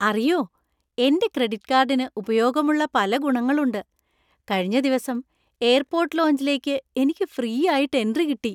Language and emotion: Malayalam, happy